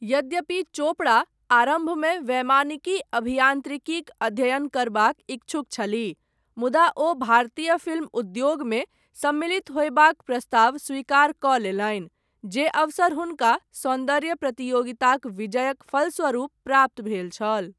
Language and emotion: Maithili, neutral